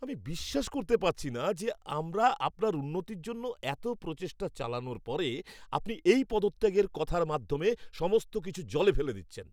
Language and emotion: Bengali, angry